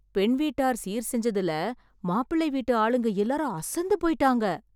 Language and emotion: Tamil, surprised